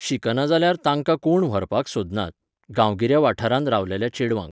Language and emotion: Goan Konkani, neutral